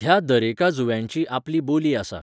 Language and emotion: Goan Konkani, neutral